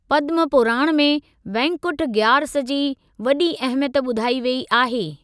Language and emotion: Sindhi, neutral